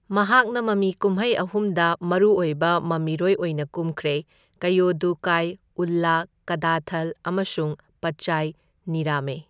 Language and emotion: Manipuri, neutral